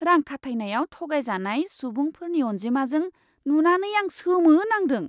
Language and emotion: Bodo, surprised